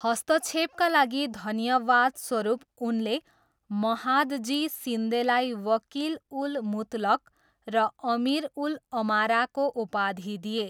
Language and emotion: Nepali, neutral